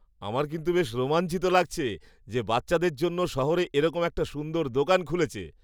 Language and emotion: Bengali, happy